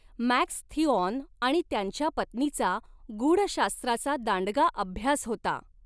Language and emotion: Marathi, neutral